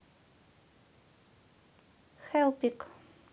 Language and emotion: Russian, neutral